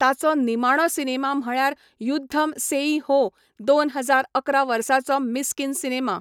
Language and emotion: Goan Konkani, neutral